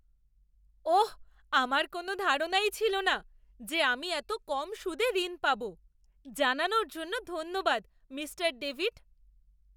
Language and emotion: Bengali, surprised